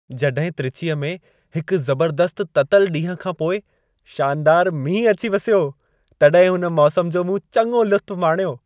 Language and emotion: Sindhi, happy